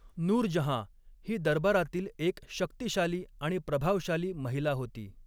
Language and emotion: Marathi, neutral